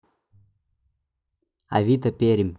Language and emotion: Russian, neutral